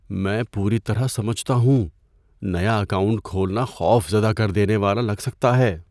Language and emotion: Urdu, fearful